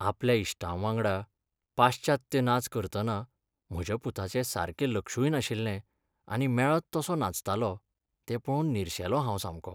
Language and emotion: Goan Konkani, sad